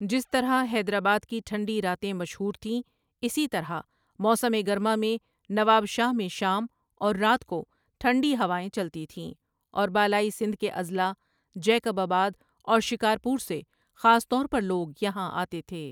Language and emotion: Urdu, neutral